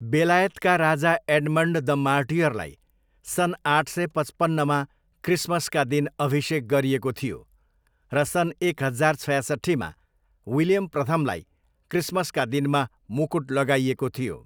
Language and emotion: Nepali, neutral